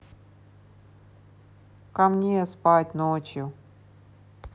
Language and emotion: Russian, neutral